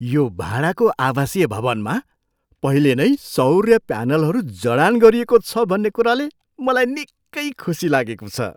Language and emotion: Nepali, surprised